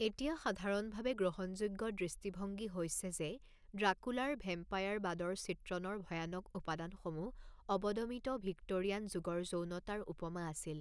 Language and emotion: Assamese, neutral